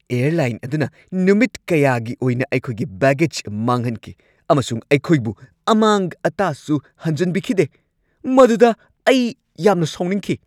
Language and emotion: Manipuri, angry